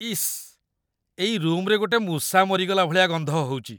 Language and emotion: Odia, disgusted